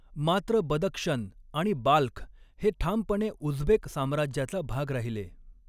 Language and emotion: Marathi, neutral